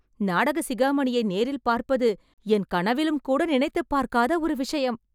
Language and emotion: Tamil, happy